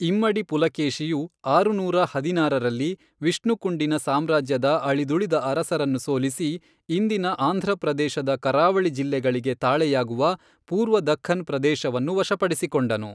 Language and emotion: Kannada, neutral